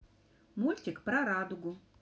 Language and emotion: Russian, positive